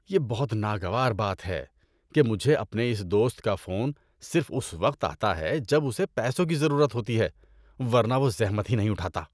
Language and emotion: Urdu, disgusted